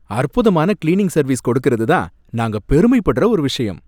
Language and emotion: Tamil, happy